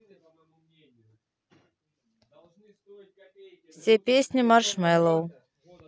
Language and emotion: Russian, neutral